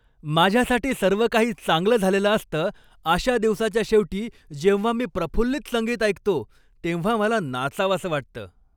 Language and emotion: Marathi, happy